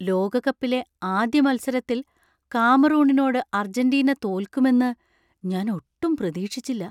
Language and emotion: Malayalam, surprised